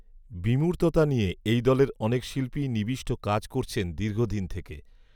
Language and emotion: Bengali, neutral